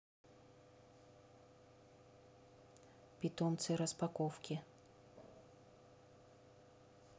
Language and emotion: Russian, neutral